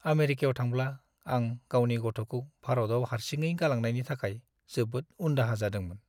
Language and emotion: Bodo, sad